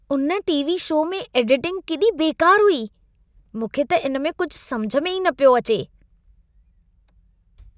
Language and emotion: Sindhi, disgusted